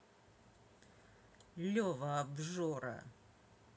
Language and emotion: Russian, angry